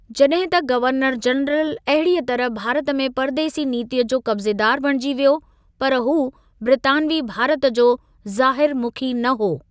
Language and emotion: Sindhi, neutral